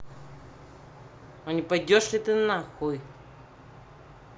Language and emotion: Russian, angry